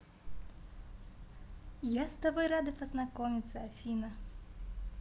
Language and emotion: Russian, positive